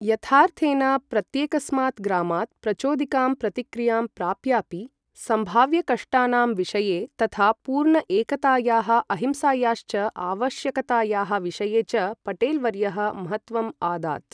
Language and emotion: Sanskrit, neutral